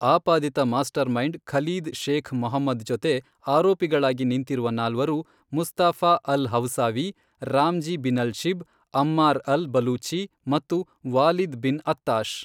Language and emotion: Kannada, neutral